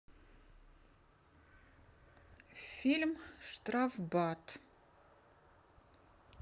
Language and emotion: Russian, neutral